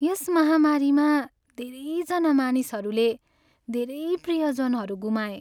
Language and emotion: Nepali, sad